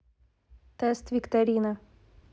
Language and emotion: Russian, neutral